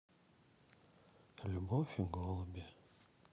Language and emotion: Russian, sad